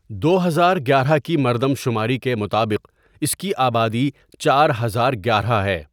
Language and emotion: Urdu, neutral